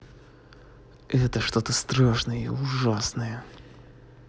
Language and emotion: Russian, angry